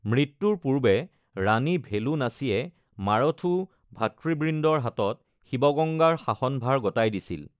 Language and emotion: Assamese, neutral